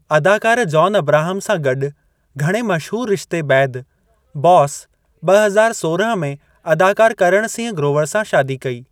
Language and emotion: Sindhi, neutral